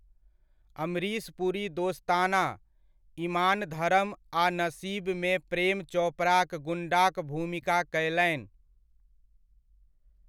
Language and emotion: Maithili, neutral